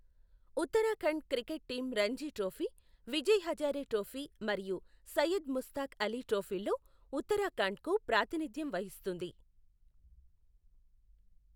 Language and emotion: Telugu, neutral